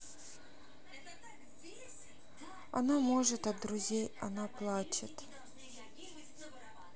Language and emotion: Russian, sad